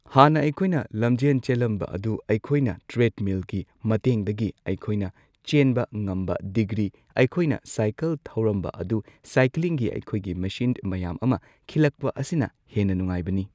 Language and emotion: Manipuri, neutral